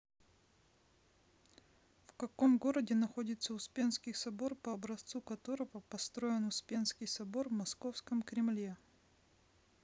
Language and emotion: Russian, neutral